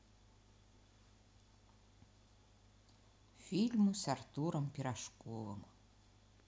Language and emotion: Russian, neutral